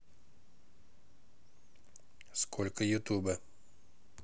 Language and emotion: Russian, neutral